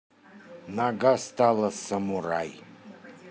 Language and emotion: Russian, neutral